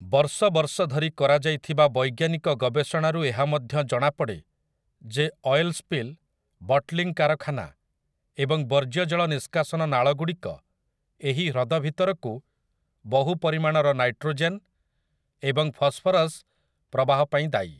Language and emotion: Odia, neutral